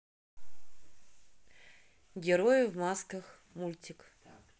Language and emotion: Russian, neutral